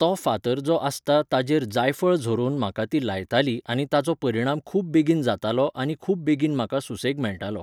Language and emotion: Goan Konkani, neutral